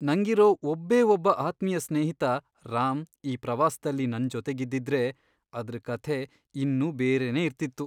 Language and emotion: Kannada, sad